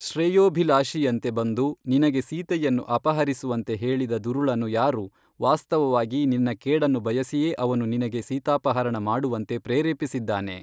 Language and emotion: Kannada, neutral